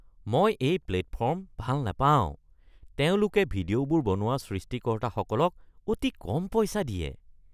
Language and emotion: Assamese, disgusted